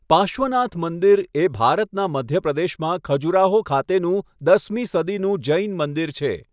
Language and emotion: Gujarati, neutral